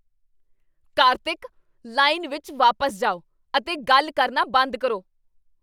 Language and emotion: Punjabi, angry